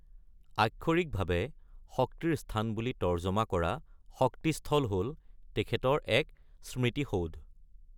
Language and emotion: Assamese, neutral